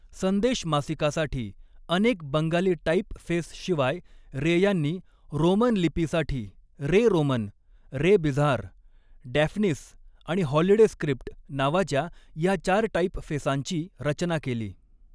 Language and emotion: Marathi, neutral